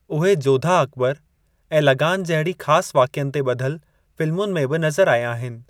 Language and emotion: Sindhi, neutral